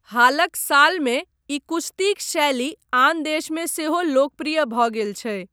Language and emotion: Maithili, neutral